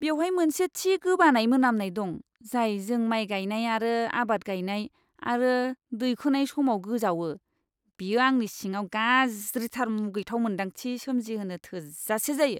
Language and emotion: Bodo, disgusted